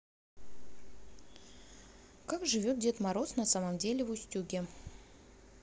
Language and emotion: Russian, neutral